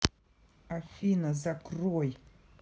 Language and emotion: Russian, angry